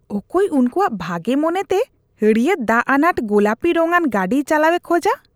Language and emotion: Santali, disgusted